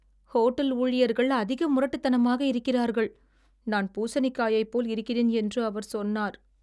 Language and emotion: Tamil, sad